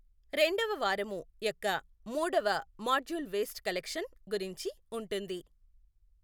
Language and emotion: Telugu, neutral